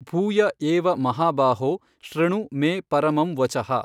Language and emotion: Kannada, neutral